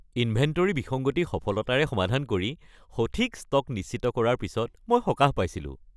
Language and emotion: Assamese, happy